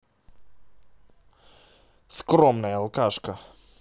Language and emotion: Russian, angry